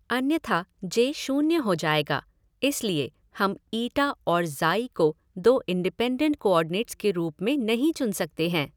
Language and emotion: Hindi, neutral